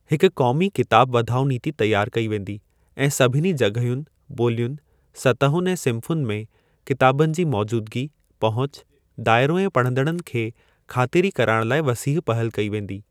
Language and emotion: Sindhi, neutral